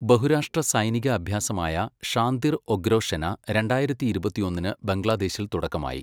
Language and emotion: Malayalam, neutral